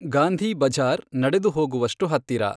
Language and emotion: Kannada, neutral